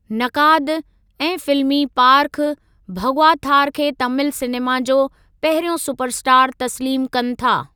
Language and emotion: Sindhi, neutral